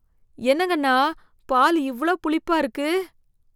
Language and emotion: Tamil, disgusted